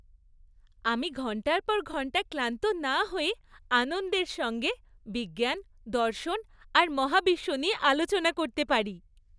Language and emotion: Bengali, happy